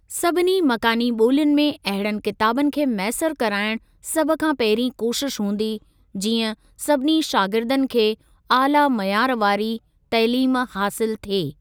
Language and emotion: Sindhi, neutral